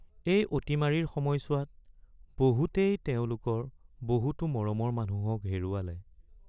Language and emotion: Assamese, sad